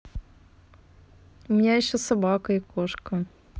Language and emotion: Russian, neutral